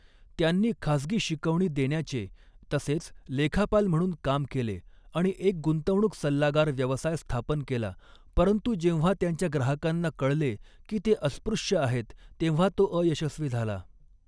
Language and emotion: Marathi, neutral